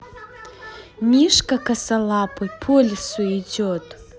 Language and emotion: Russian, positive